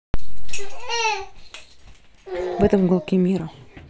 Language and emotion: Russian, neutral